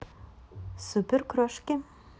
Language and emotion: Russian, positive